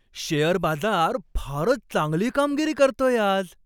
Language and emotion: Marathi, happy